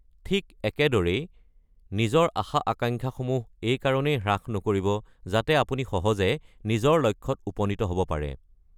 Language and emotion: Assamese, neutral